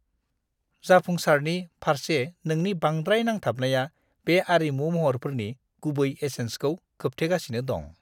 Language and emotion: Bodo, disgusted